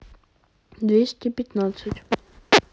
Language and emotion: Russian, neutral